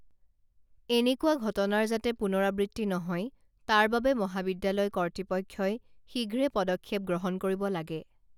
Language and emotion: Assamese, neutral